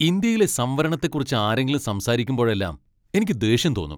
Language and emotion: Malayalam, angry